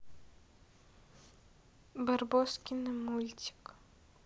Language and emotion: Russian, sad